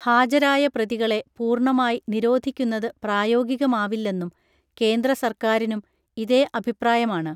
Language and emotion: Malayalam, neutral